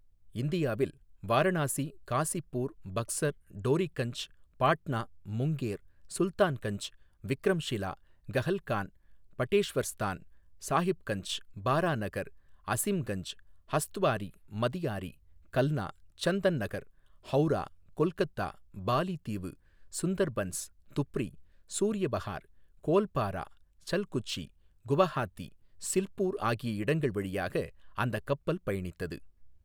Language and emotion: Tamil, neutral